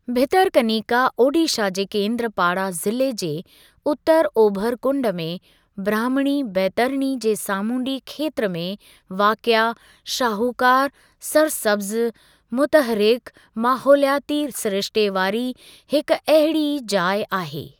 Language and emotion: Sindhi, neutral